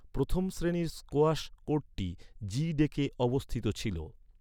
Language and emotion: Bengali, neutral